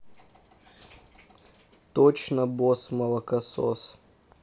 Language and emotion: Russian, neutral